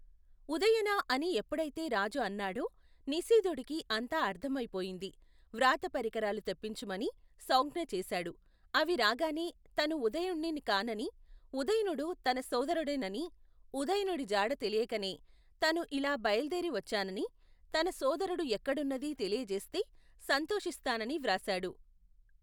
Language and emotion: Telugu, neutral